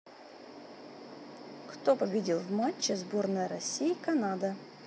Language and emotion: Russian, neutral